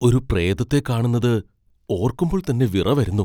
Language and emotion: Malayalam, fearful